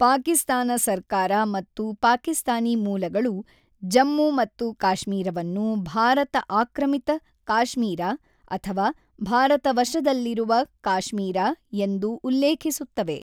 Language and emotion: Kannada, neutral